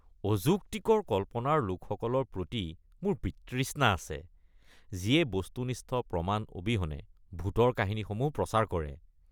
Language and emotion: Assamese, disgusted